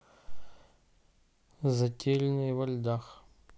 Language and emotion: Russian, neutral